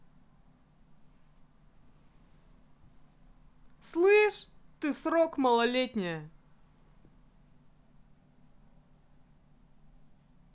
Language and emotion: Russian, angry